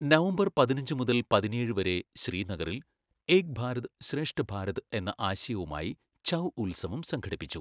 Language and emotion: Malayalam, neutral